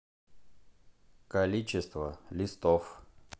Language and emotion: Russian, neutral